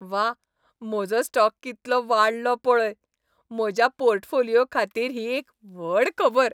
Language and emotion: Goan Konkani, happy